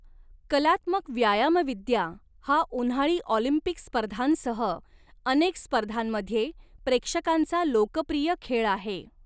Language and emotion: Marathi, neutral